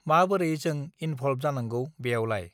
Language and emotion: Bodo, neutral